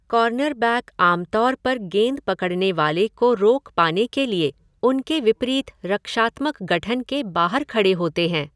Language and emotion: Hindi, neutral